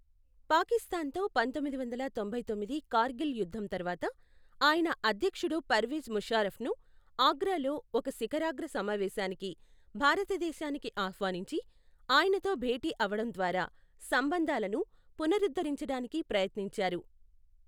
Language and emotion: Telugu, neutral